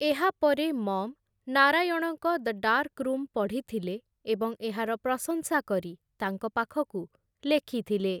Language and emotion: Odia, neutral